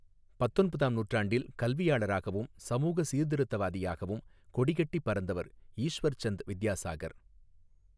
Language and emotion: Tamil, neutral